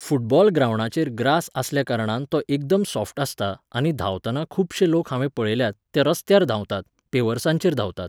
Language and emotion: Goan Konkani, neutral